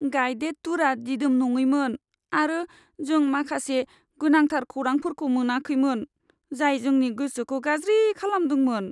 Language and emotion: Bodo, sad